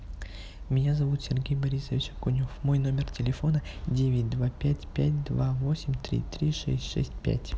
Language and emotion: Russian, neutral